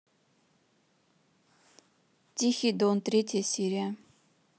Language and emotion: Russian, neutral